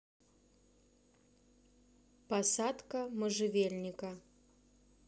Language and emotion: Russian, neutral